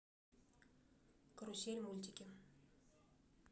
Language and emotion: Russian, neutral